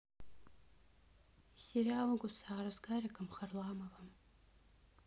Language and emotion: Russian, neutral